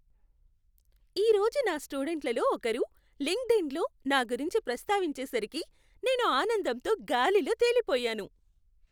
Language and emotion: Telugu, happy